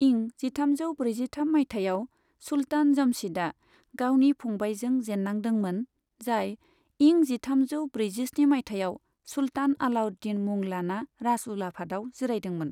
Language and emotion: Bodo, neutral